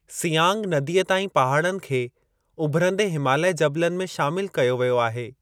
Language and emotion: Sindhi, neutral